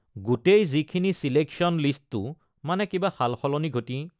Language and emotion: Assamese, neutral